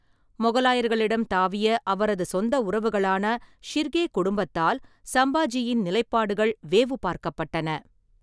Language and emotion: Tamil, neutral